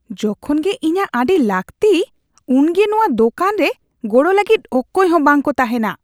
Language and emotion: Santali, disgusted